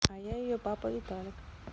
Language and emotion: Russian, neutral